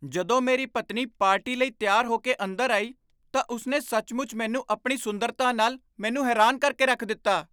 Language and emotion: Punjabi, surprised